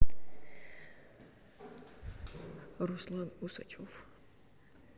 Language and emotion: Russian, neutral